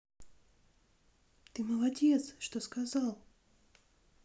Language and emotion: Russian, positive